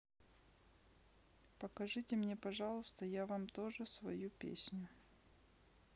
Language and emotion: Russian, neutral